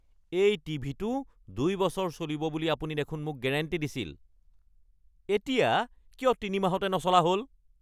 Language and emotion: Assamese, angry